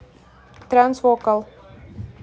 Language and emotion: Russian, neutral